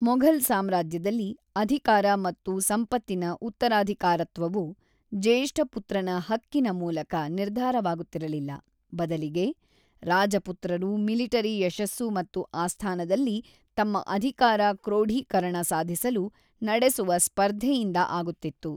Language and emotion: Kannada, neutral